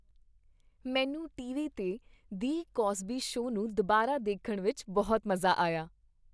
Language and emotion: Punjabi, happy